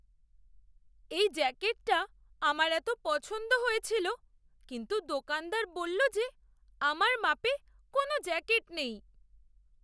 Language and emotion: Bengali, sad